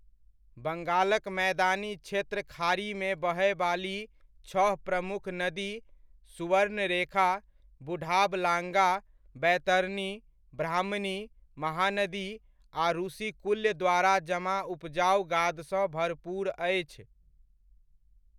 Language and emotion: Maithili, neutral